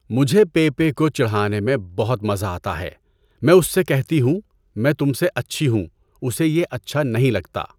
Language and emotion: Urdu, neutral